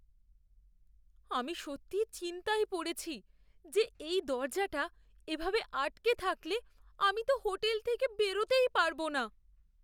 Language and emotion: Bengali, fearful